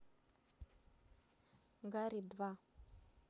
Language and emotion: Russian, neutral